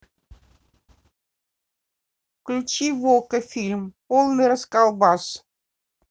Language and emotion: Russian, neutral